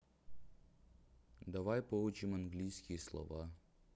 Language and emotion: Russian, neutral